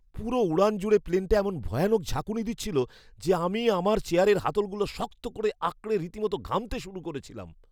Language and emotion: Bengali, fearful